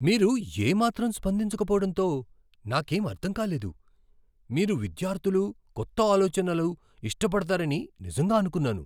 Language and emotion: Telugu, surprised